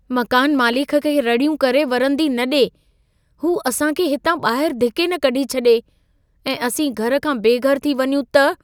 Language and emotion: Sindhi, fearful